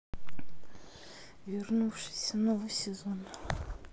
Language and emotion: Russian, sad